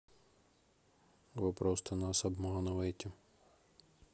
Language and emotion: Russian, sad